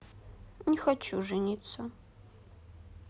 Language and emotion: Russian, sad